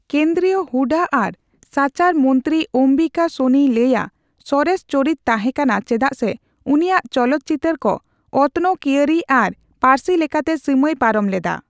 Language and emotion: Santali, neutral